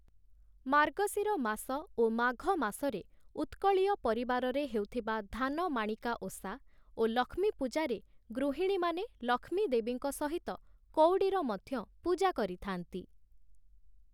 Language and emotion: Odia, neutral